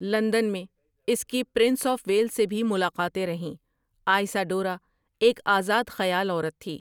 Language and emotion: Urdu, neutral